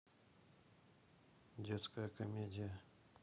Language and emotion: Russian, neutral